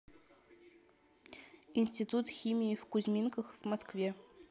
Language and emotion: Russian, neutral